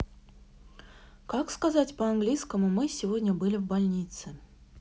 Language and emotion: Russian, neutral